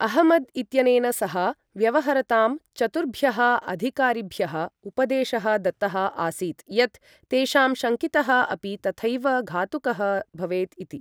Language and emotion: Sanskrit, neutral